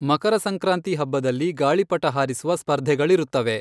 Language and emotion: Kannada, neutral